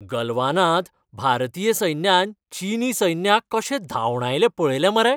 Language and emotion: Goan Konkani, happy